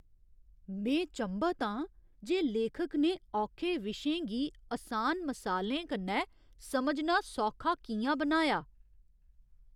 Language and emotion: Dogri, surprised